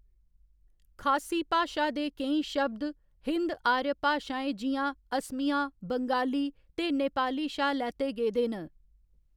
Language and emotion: Dogri, neutral